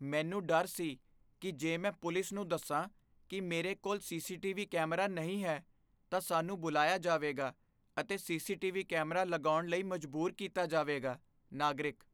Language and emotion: Punjabi, fearful